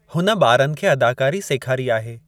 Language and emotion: Sindhi, neutral